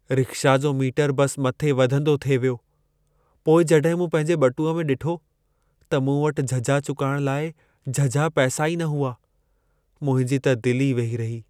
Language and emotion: Sindhi, sad